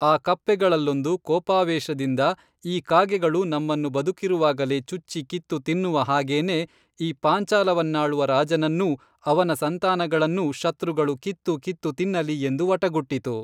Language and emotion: Kannada, neutral